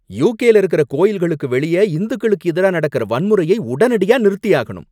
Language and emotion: Tamil, angry